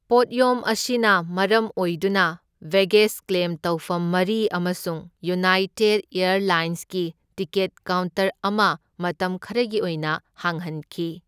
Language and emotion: Manipuri, neutral